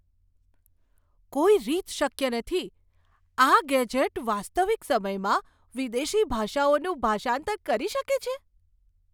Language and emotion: Gujarati, surprised